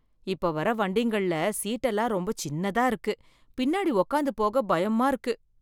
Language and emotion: Tamil, fearful